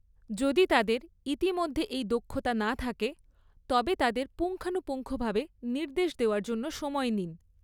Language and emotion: Bengali, neutral